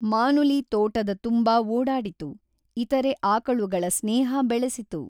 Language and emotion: Kannada, neutral